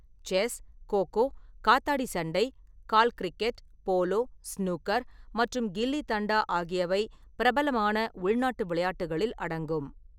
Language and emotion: Tamil, neutral